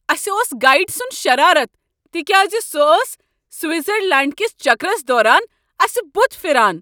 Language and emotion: Kashmiri, angry